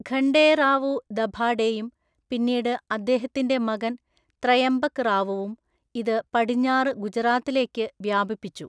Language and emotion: Malayalam, neutral